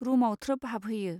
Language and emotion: Bodo, neutral